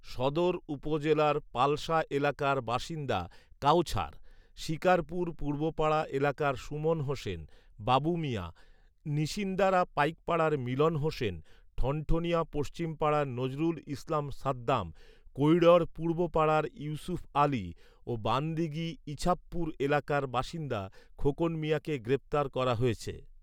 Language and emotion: Bengali, neutral